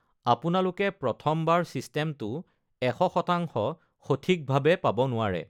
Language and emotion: Assamese, neutral